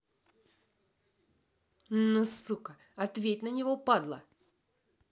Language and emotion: Russian, angry